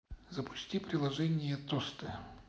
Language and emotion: Russian, neutral